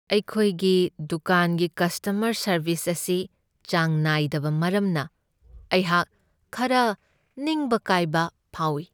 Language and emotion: Manipuri, sad